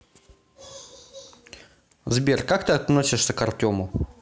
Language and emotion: Russian, neutral